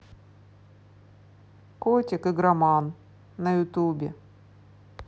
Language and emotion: Russian, neutral